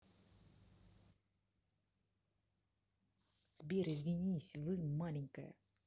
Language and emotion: Russian, neutral